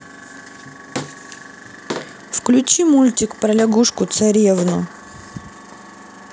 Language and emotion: Russian, neutral